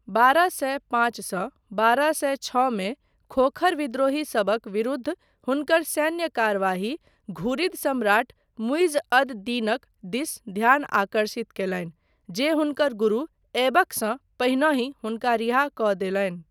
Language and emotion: Maithili, neutral